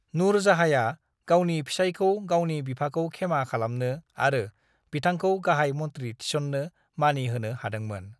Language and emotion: Bodo, neutral